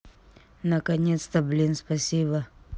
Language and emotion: Russian, neutral